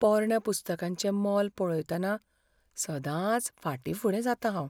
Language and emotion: Goan Konkani, fearful